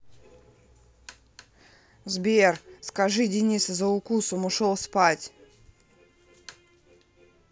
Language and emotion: Russian, angry